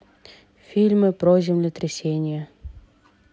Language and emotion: Russian, neutral